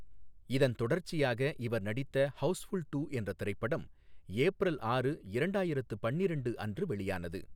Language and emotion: Tamil, neutral